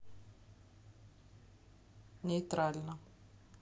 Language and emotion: Russian, neutral